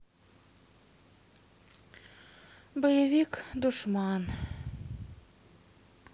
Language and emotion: Russian, sad